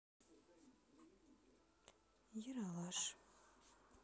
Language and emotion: Russian, sad